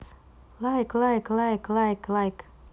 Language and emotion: Russian, positive